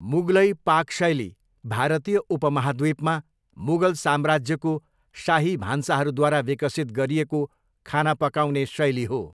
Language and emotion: Nepali, neutral